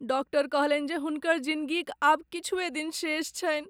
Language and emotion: Maithili, sad